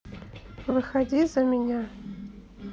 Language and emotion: Russian, neutral